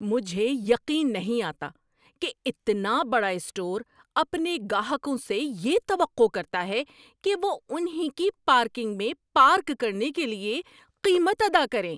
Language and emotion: Urdu, angry